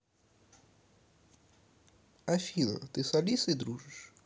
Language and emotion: Russian, neutral